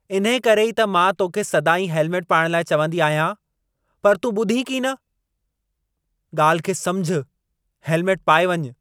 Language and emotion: Sindhi, angry